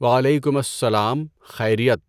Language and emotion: Urdu, neutral